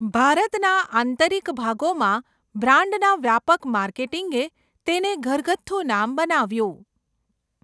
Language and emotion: Gujarati, neutral